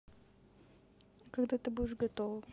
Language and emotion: Russian, neutral